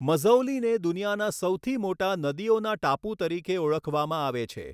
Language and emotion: Gujarati, neutral